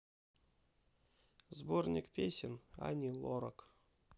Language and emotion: Russian, sad